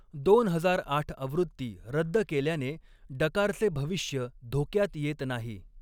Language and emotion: Marathi, neutral